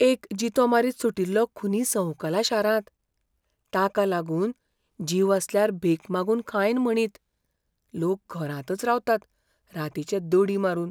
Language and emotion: Goan Konkani, fearful